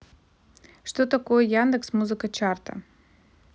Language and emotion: Russian, neutral